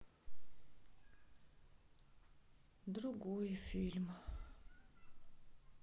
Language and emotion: Russian, sad